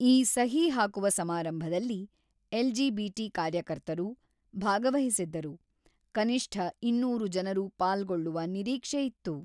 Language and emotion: Kannada, neutral